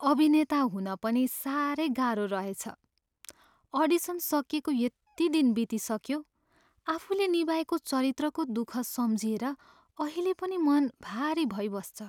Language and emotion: Nepali, sad